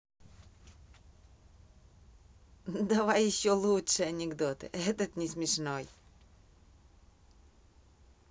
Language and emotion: Russian, positive